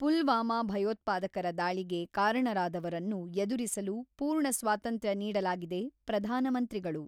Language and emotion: Kannada, neutral